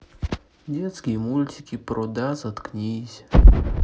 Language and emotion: Russian, sad